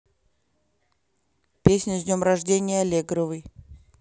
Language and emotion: Russian, neutral